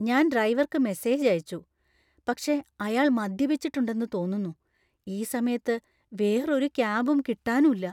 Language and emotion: Malayalam, fearful